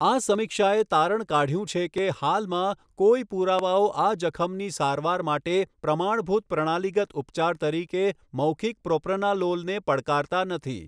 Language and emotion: Gujarati, neutral